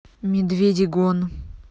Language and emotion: Russian, neutral